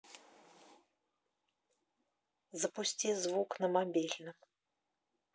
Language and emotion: Russian, neutral